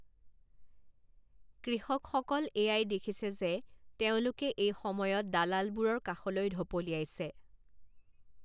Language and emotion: Assamese, neutral